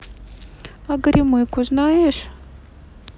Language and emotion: Russian, neutral